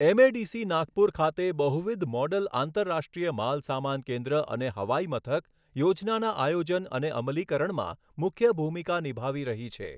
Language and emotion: Gujarati, neutral